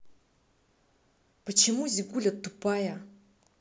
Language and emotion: Russian, angry